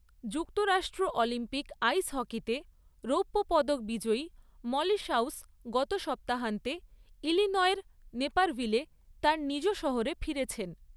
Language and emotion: Bengali, neutral